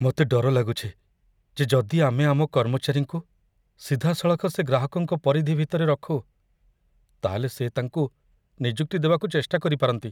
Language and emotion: Odia, fearful